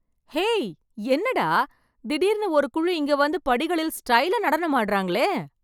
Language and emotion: Tamil, surprised